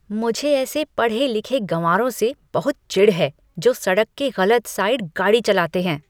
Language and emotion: Hindi, disgusted